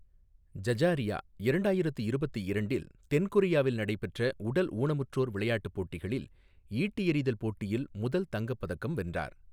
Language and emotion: Tamil, neutral